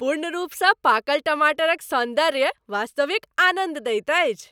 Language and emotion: Maithili, happy